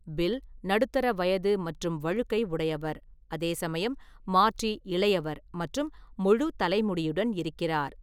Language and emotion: Tamil, neutral